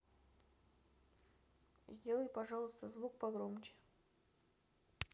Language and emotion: Russian, neutral